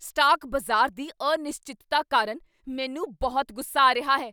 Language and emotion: Punjabi, angry